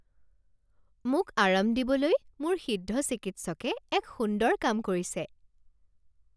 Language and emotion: Assamese, happy